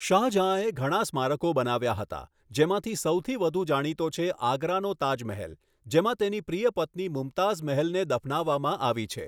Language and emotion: Gujarati, neutral